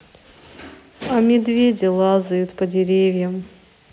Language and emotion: Russian, sad